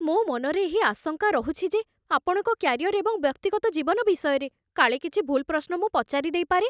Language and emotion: Odia, fearful